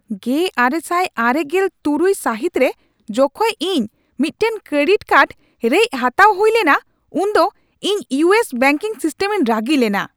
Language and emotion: Santali, angry